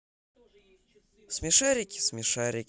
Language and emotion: Russian, positive